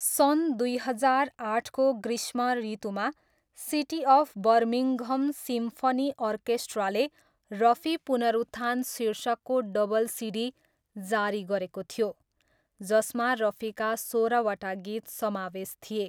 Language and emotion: Nepali, neutral